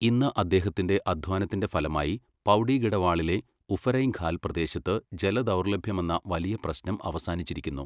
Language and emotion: Malayalam, neutral